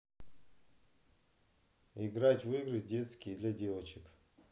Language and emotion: Russian, neutral